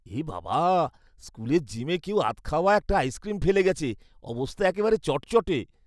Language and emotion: Bengali, disgusted